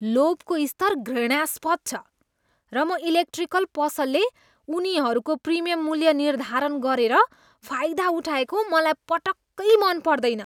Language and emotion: Nepali, disgusted